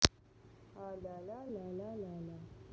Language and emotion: Russian, neutral